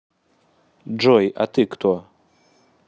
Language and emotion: Russian, neutral